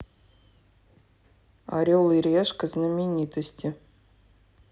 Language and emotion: Russian, neutral